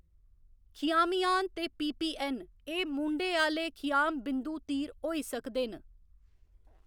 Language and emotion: Dogri, neutral